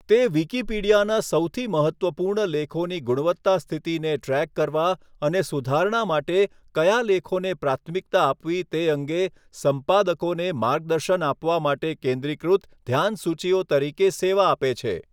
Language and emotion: Gujarati, neutral